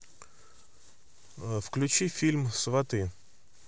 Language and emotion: Russian, neutral